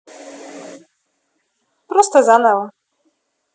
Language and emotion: Russian, neutral